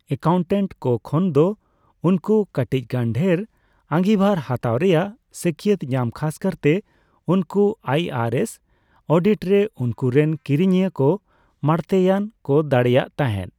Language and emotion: Santali, neutral